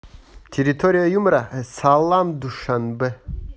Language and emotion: Russian, positive